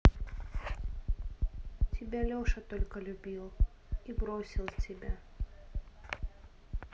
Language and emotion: Russian, sad